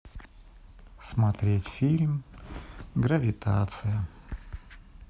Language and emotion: Russian, sad